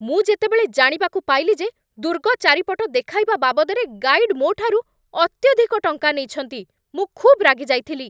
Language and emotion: Odia, angry